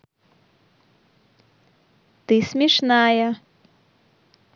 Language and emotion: Russian, positive